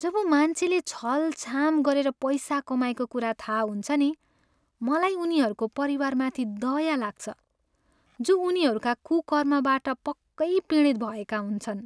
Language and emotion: Nepali, sad